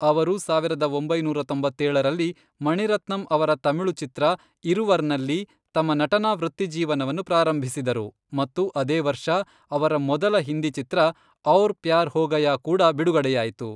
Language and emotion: Kannada, neutral